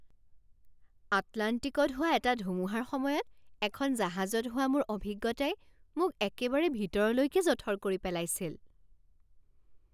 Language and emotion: Assamese, surprised